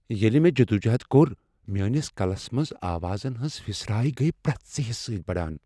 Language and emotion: Kashmiri, fearful